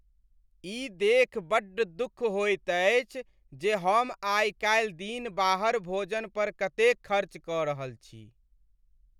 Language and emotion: Maithili, sad